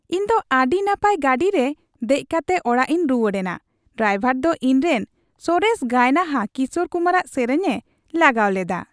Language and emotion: Santali, happy